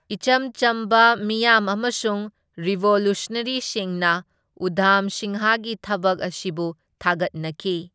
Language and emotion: Manipuri, neutral